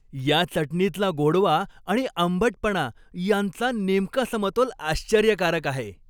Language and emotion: Marathi, happy